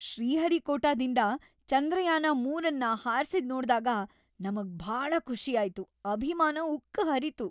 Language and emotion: Kannada, happy